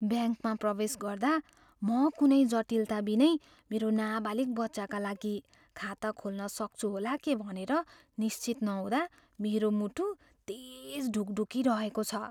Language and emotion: Nepali, fearful